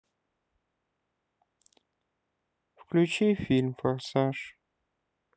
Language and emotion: Russian, sad